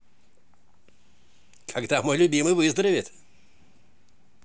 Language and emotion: Russian, positive